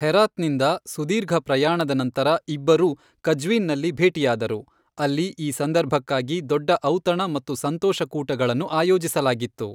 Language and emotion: Kannada, neutral